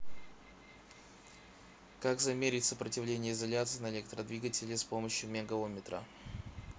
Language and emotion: Russian, neutral